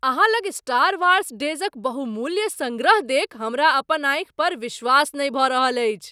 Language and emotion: Maithili, surprised